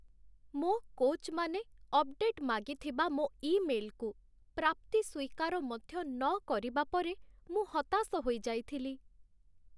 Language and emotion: Odia, sad